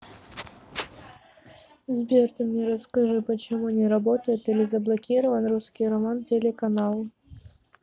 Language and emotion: Russian, neutral